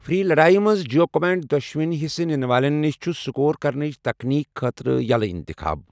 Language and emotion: Kashmiri, neutral